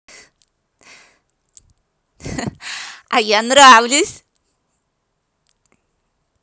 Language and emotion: Russian, positive